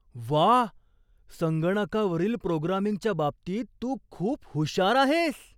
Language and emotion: Marathi, surprised